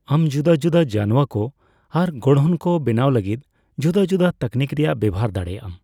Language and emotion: Santali, neutral